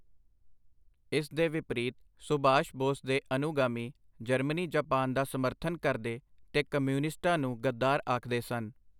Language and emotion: Punjabi, neutral